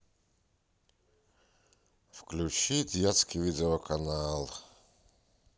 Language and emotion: Russian, sad